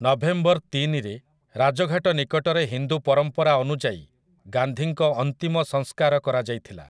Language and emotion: Odia, neutral